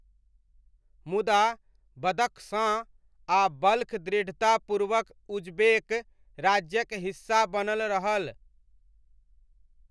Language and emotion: Maithili, neutral